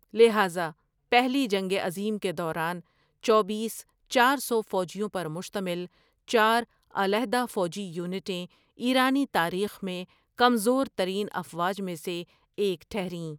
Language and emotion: Urdu, neutral